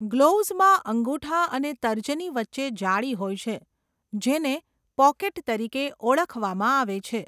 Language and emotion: Gujarati, neutral